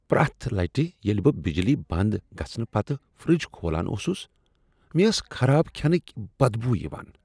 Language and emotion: Kashmiri, disgusted